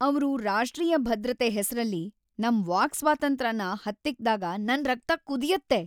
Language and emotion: Kannada, angry